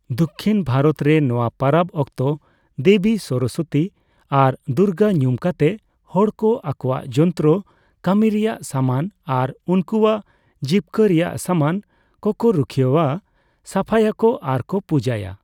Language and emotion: Santali, neutral